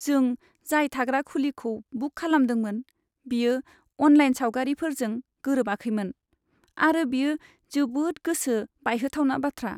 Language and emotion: Bodo, sad